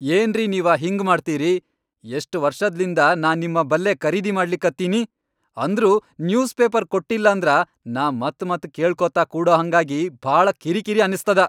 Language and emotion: Kannada, angry